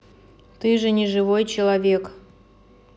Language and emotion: Russian, neutral